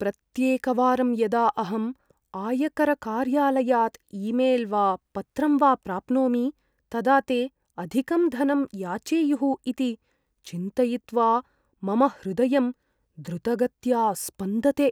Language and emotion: Sanskrit, fearful